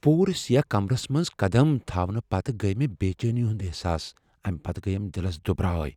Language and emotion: Kashmiri, fearful